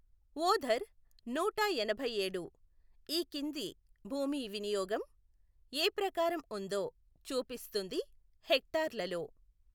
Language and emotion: Telugu, neutral